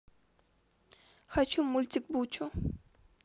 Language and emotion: Russian, neutral